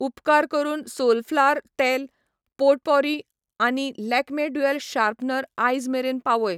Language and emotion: Goan Konkani, neutral